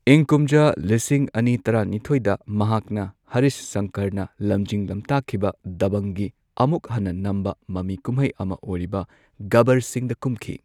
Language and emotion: Manipuri, neutral